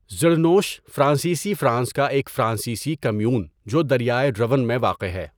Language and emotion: Urdu, neutral